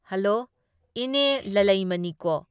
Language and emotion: Manipuri, neutral